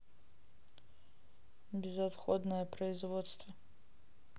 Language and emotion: Russian, neutral